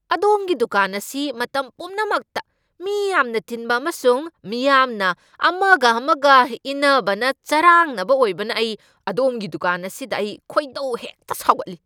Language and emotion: Manipuri, angry